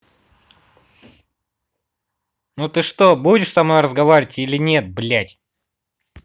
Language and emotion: Russian, angry